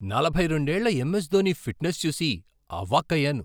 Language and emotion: Telugu, surprised